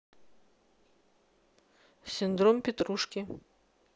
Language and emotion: Russian, neutral